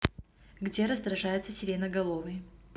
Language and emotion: Russian, neutral